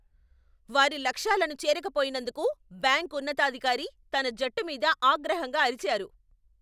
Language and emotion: Telugu, angry